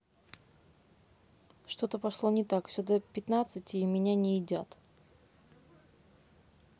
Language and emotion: Russian, neutral